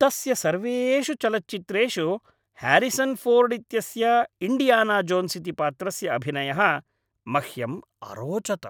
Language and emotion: Sanskrit, happy